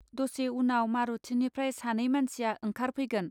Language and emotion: Bodo, neutral